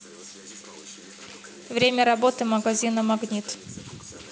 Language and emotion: Russian, neutral